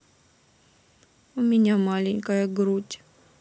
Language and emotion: Russian, sad